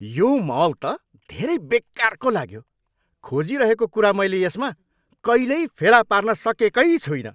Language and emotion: Nepali, angry